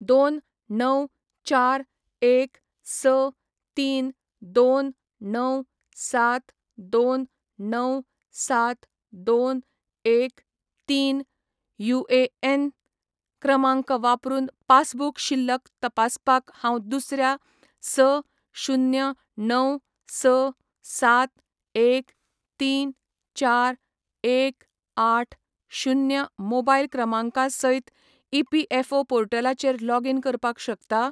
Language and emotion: Goan Konkani, neutral